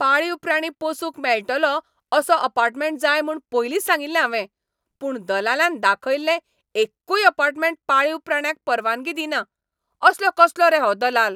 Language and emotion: Goan Konkani, angry